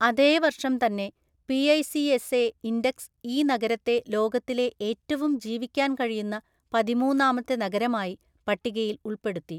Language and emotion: Malayalam, neutral